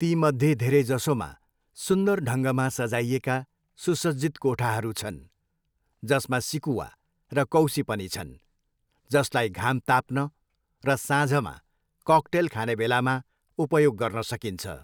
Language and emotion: Nepali, neutral